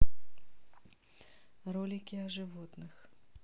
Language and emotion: Russian, neutral